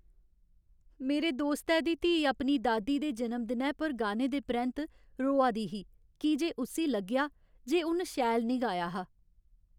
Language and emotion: Dogri, sad